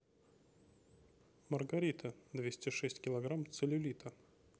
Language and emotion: Russian, neutral